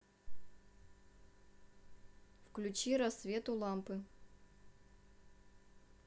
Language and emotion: Russian, neutral